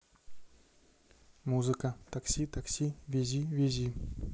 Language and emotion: Russian, neutral